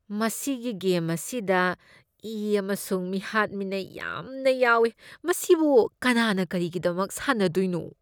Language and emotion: Manipuri, disgusted